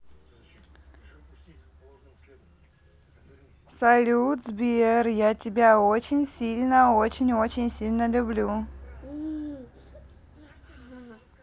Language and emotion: Russian, positive